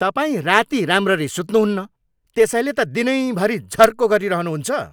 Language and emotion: Nepali, angry